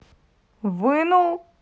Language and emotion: Russian, neutral